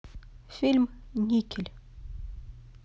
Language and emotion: Russian, neutral